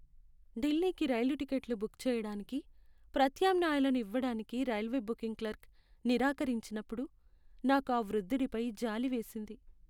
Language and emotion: Telugu, sad